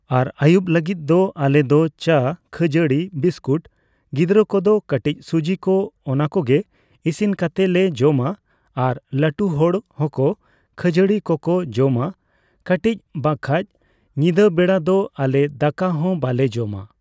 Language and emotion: Santali, neutral